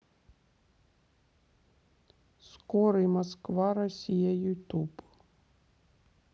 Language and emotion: Russian, neutral